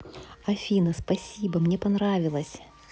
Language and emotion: Russian, positive